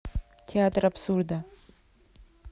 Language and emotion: Russian, neutral